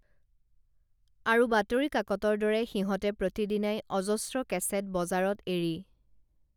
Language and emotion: Assamese, neutral